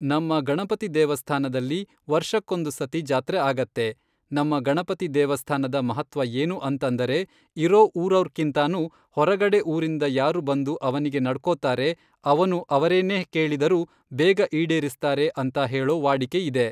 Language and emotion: Kannada, neutral